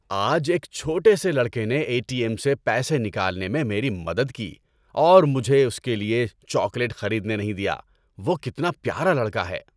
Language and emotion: Urdu, happy